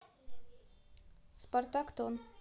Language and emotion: Russian, neutral